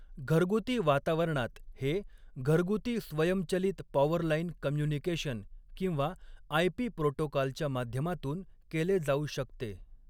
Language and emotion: Marathi, neutral